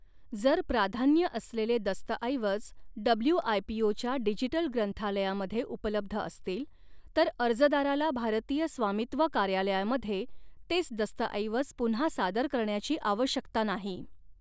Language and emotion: Marathi, neutral